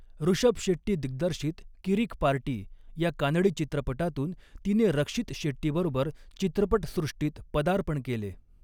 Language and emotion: Marathi, neutral